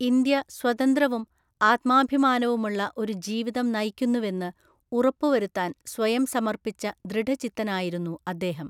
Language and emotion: Malayalam, neutral